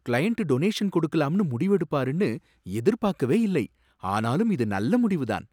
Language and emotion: Tamil, surprised